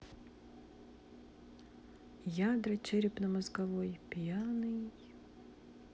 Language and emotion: Russian, sad